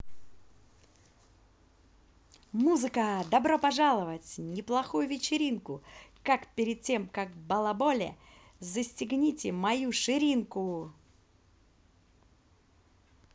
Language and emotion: Russian, positive